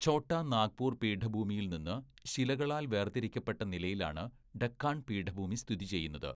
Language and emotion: Malayalam, neutral